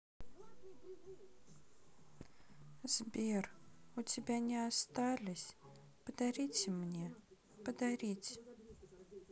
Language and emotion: Russian, sad